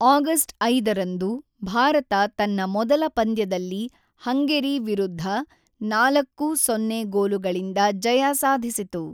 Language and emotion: Kannada, neutral